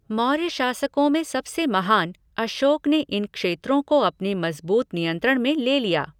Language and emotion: Hindi, neutral